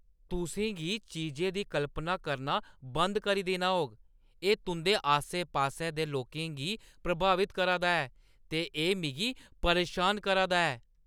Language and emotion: Dogri, angry